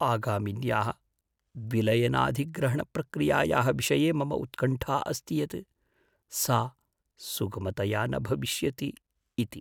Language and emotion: Sanskrit, fearful